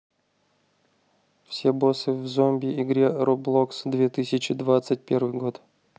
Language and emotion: Russian, neutral